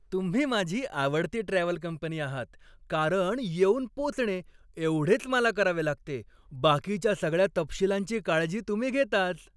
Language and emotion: Marathi, happy